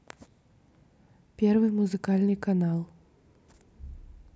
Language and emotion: Russian, neutral